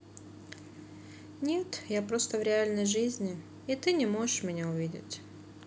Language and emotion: Russian, sad